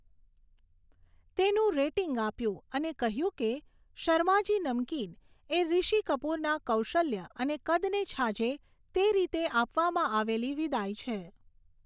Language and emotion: Gujarati, neutral